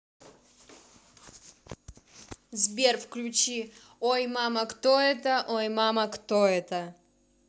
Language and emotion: Russian, neutral